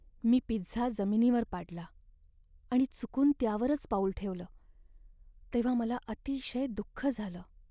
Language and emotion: Marathi, sad